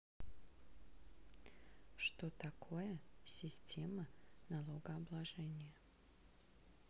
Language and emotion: Russian, neutral